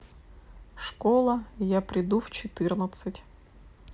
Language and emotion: Russian, neutral